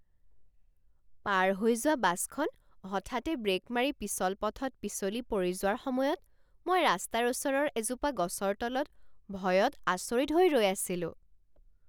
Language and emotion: Assamese, surprised